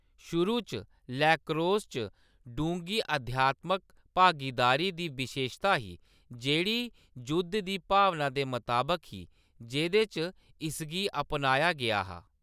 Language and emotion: Dogri, neutral